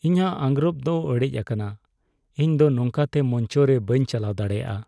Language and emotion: Santali, sad